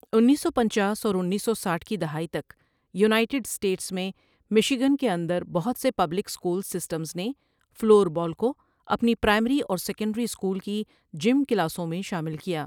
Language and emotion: Urdu, neutral